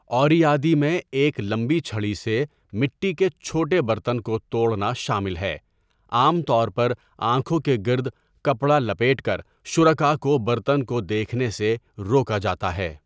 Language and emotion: Urdu, neutral